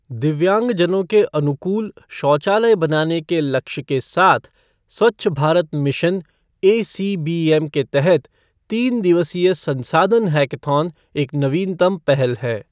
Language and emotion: Hindi, neutral